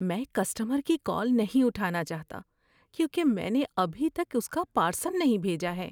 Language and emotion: Urdu, fearful